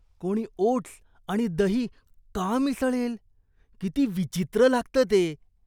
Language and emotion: Marathi, disgusted